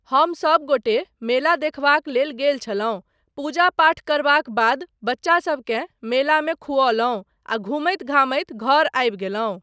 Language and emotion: Maithili, neutral